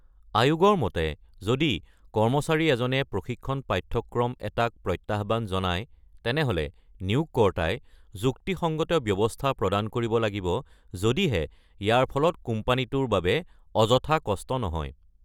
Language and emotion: Assamese, neutral